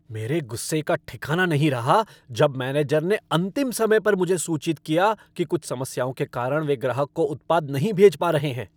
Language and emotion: Hindi, angry